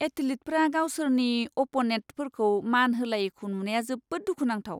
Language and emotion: Bodo, disgusted